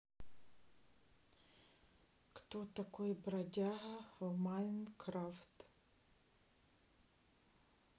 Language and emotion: Russian, neutral